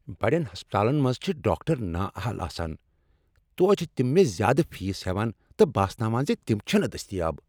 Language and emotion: Kashmiri, angry